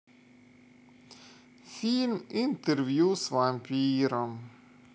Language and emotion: Russian, sad